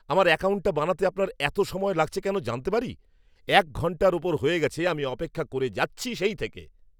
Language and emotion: Bengali, angry